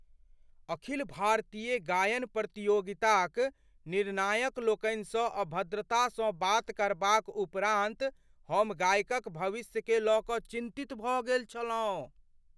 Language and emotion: Maithili, fearful